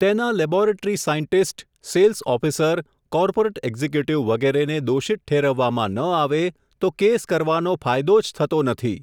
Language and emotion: Gujarati, neutral